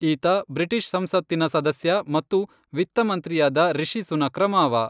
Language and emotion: Kannada, neutral